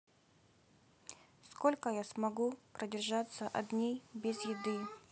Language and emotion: Russian, sad